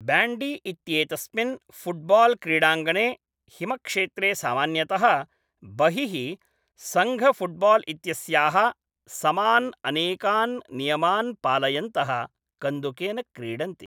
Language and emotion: Sanskrit, neutral